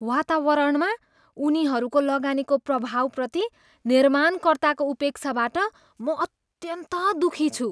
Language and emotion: Nepali, disgusted